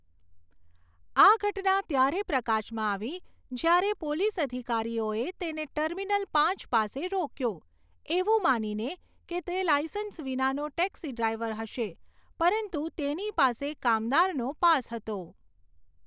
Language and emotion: Gujarati, neutral